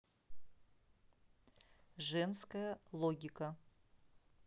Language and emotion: Russian, neutral